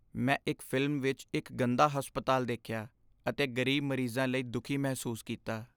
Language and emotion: Punjabi, sad